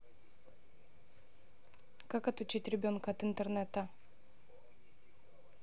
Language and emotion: Russian, neutral